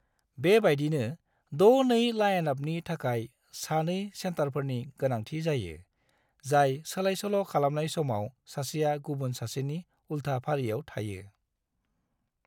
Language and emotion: Bodo, neutral